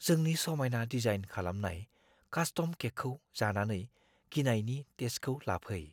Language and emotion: Bodo, fearful